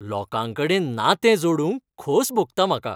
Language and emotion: Goan Konkani, happy